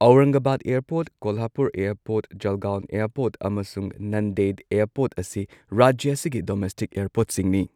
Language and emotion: Manipuri, neutral